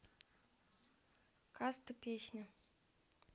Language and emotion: Russian, neutral